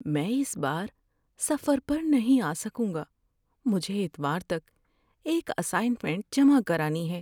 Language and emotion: Urdu, sad